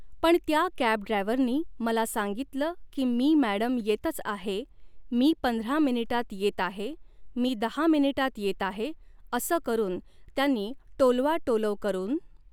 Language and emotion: Marathi, neutral